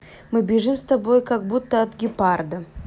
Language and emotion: Russian, neutral